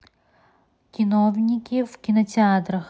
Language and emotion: Russian, neutral